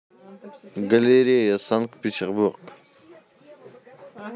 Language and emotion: Russian, neutral